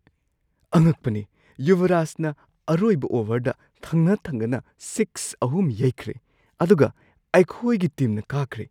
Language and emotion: Manipuri, surprised